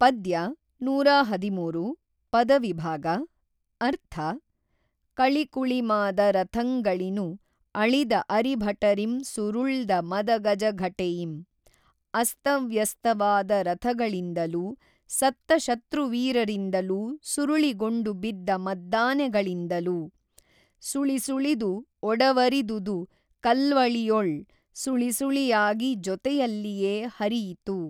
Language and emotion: Kannada, neutral